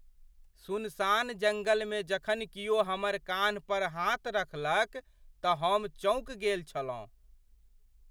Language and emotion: Maithili, surprised